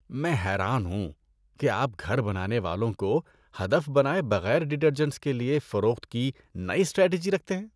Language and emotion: Urdu, disgusted